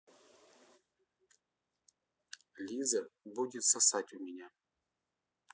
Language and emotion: Russian, neutral